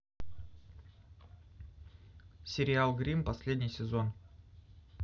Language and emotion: Russian, neutral